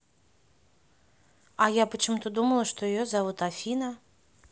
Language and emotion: Russian, neutral